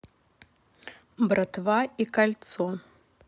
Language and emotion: Russian, neutral